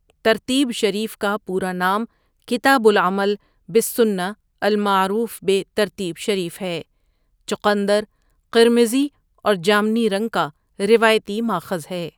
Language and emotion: Urdu, neutral